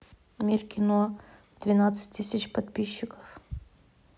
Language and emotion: Russian, neutral